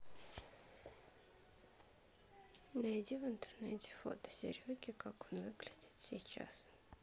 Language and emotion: Russian, sad